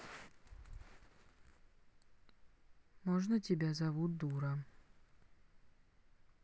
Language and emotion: Russian, neutral